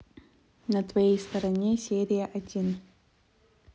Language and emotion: Russian, neutral